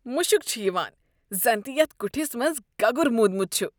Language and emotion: Kashmiri, disgusted